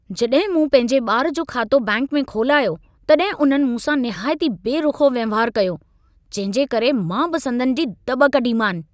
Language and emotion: Sindhi, angry